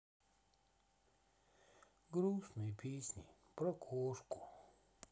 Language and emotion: Russian, sad